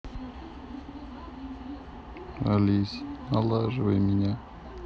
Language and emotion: Russian, sad